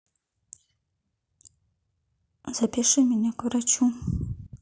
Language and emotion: Russian, sad